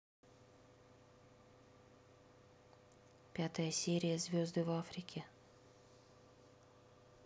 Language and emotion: Russian, neutral